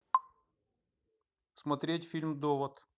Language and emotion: Russian, neutral